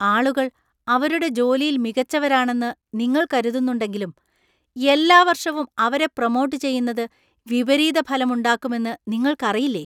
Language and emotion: Malayalam, disgusted